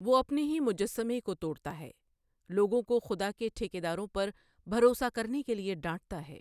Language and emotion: Urdu, neutral